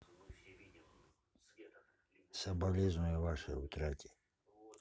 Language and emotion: Russian, sad